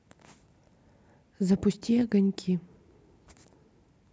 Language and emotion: Russian, neutral